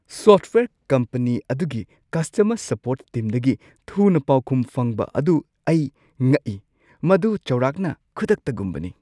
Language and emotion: Manipuri, surprised